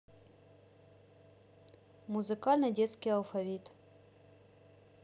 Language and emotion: Russian, neutral